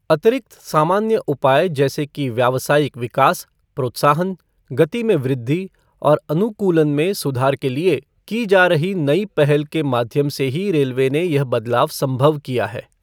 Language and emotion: Hindi, neutral